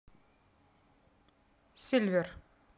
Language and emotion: Russian, neutral